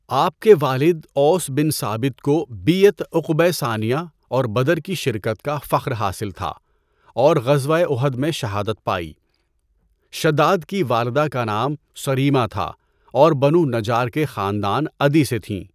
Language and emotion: Urdu, neutral